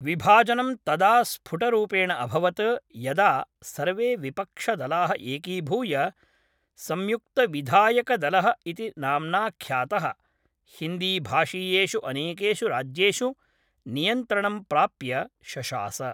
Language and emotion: Sanskrit, neutral